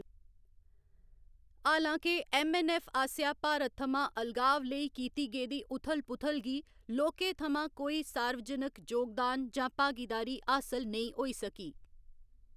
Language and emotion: Dogri, neutral